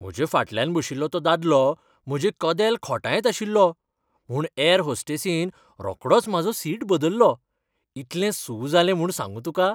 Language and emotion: Goan Konkani, happy